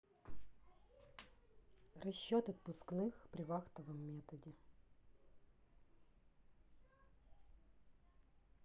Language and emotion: Russian, neutral